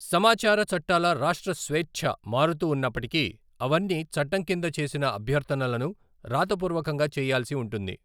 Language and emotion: Telugu, neutral